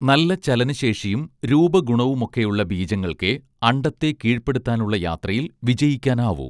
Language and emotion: Malayalam, neutral